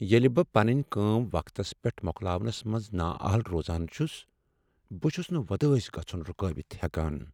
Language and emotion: Kashmiri, sad